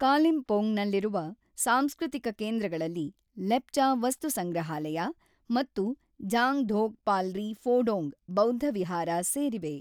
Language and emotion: Kannada, neutral